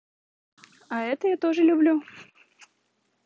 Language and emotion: Russian, positive